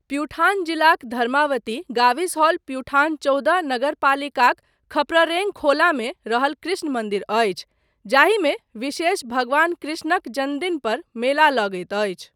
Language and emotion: Maithili, neutral